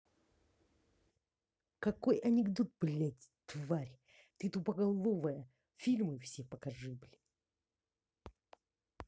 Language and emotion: Russian, angry